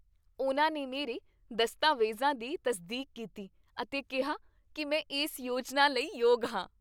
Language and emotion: Punjabi, happy